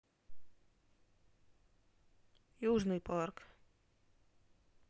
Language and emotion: Russian, neutral